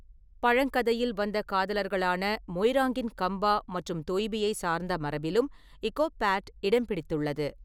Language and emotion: Tamil, neutral